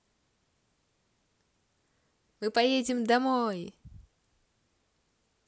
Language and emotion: Russian, positive